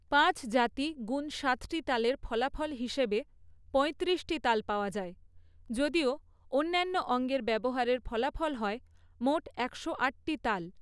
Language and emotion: Bengali, neutral